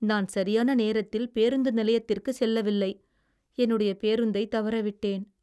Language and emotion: Tamil, sad